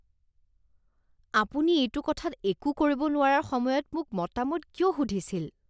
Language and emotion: Assamese, disgusted